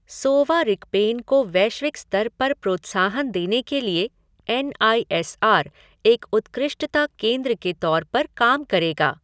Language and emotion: Hindi, neutral